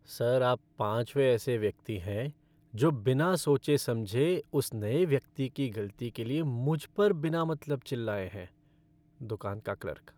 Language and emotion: Hindi, sad